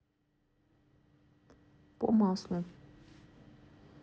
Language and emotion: Russian, neutral